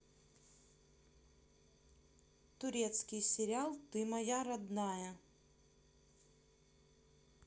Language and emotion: Russian, neutral